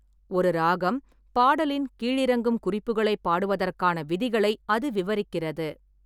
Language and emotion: Tamil, neutral